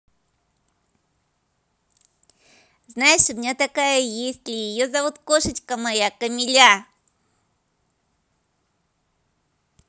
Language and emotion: Russian, positive